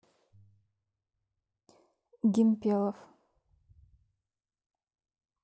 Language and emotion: Russian, neutral